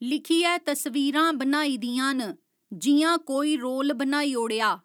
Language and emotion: Dogri, neutral